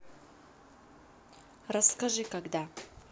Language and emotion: Russian, neutral